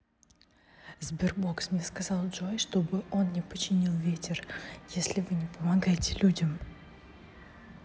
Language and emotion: Russian, neutral